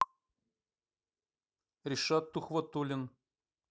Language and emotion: Russian, neutral